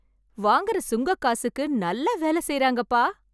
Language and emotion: Tamil, happy